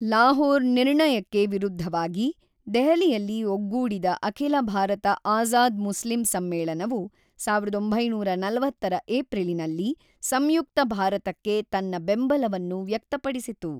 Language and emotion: Kannada, neutral